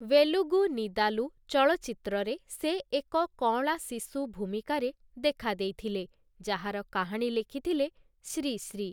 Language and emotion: Odia, neutral